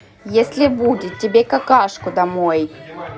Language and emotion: Russian, neutral